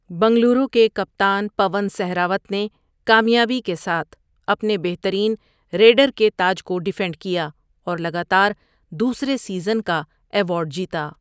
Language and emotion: Urdu, neutral